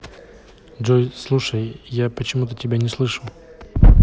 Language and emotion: Russian, neutral